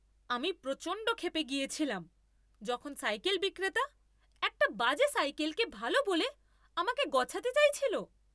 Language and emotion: Bengali, angry